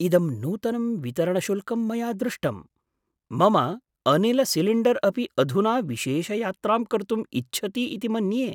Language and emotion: Sanskrit, surprised